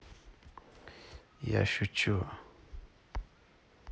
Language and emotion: Russian, neutral